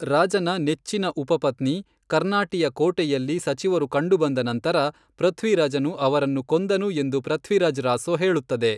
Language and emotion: Kannada, neutral